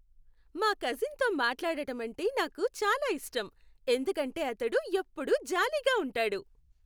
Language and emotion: Telugu, happy